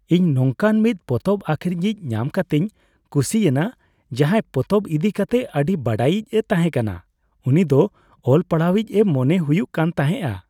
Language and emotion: Santali, happy